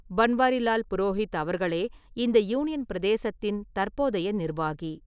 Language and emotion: Tamil, neutral